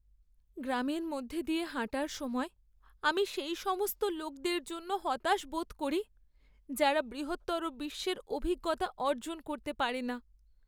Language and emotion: Bengali, sad